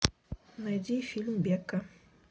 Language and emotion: Russian, neutral